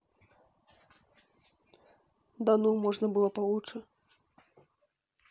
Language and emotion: Russian, neutral